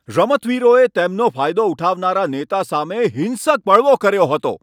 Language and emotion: Gujarati, angry